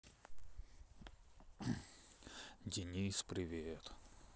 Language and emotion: Russian, sad